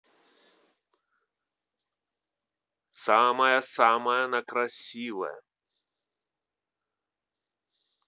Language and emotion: Russian, positive